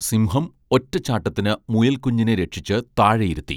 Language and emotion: Malayalam, neutral